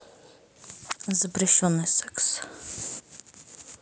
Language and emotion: Russian, neutral